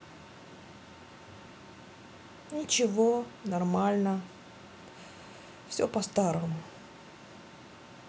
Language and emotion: Russian, sad